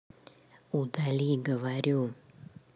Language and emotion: Russian, neutral